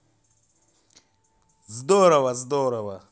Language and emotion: Russian, positive